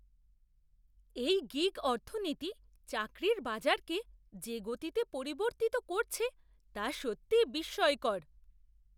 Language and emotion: Bengali, surprised